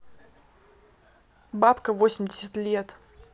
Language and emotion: Russian, angry